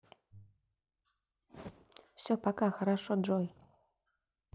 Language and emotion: Russian, neutral